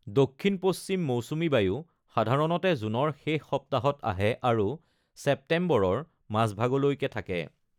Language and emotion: Assamese, neutral